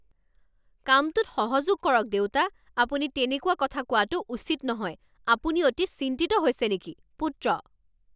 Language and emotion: Assamese, angry